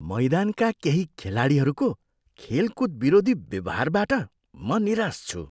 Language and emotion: Nepali, disgusted